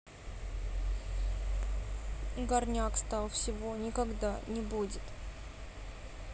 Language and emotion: Russian, sad